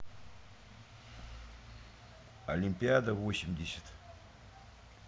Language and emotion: Russian, neutral